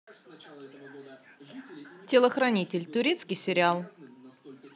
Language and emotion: Russian, neutral